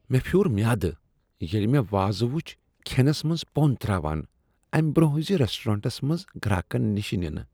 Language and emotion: Kashmiri, disgusted